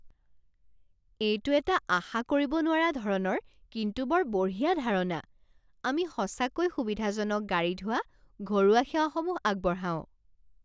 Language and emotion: Assamese, surprised